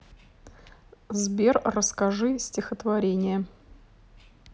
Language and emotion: Russian, neutral